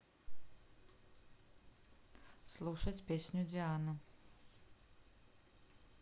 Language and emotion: Russian, neutral